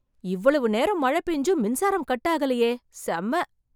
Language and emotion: Tamil, surprised